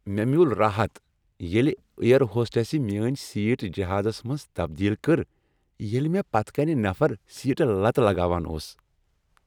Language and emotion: Kashmiri, happy